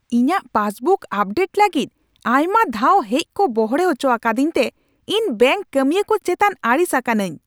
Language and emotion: Santali, angry